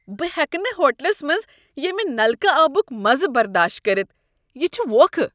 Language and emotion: Kashmiri, disgusted